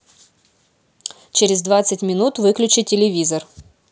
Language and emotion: Russian, neutral